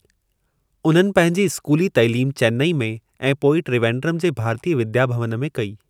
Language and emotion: Sindhi, neutral